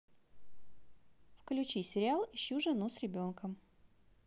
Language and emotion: Russian, positive